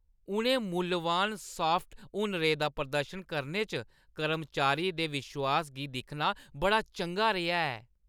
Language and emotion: Dogri, happy